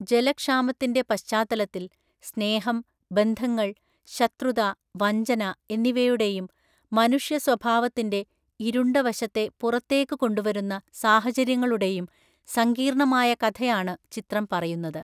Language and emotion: Malayalam, neutral